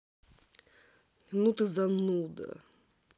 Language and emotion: Russian, angry